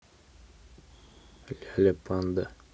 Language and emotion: Russian, neutral